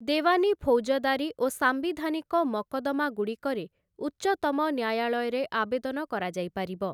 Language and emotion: Odia, neutral